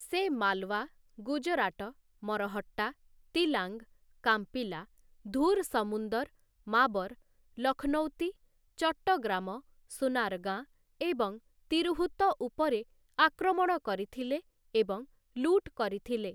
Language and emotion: Odia, neutral